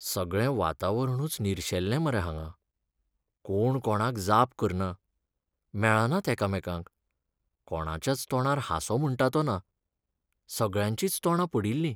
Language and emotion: Goan Konkani, sad